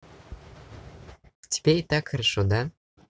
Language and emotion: Russian, positive